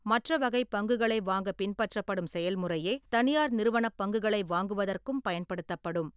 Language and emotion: Tamil, neutral